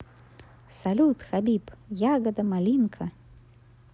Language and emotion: Russian, positive